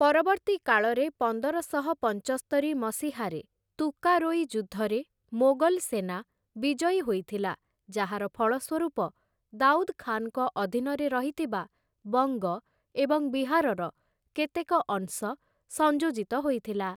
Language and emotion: Odia, neutral